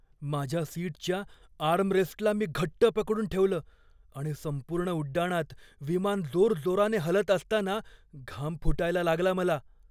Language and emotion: Marathi, fearful